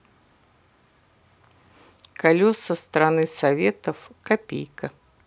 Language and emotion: Russian, neutral